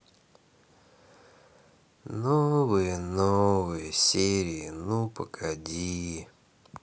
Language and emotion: Russian, sad